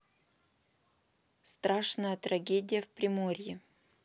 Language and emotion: Russian, neutral